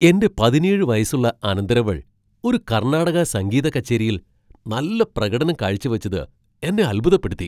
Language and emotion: Malayalam, surprised